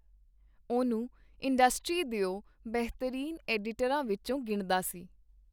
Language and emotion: Punjabi, neutral